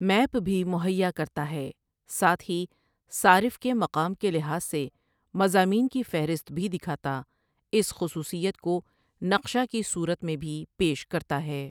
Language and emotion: Urdu, neutral